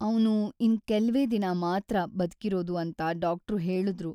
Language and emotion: Kannada, sad